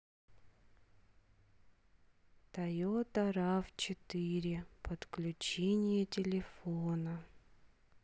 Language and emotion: Russian, sad